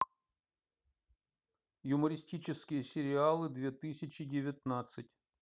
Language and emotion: Russian, neutral